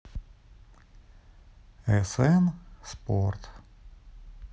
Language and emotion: Russian, neutral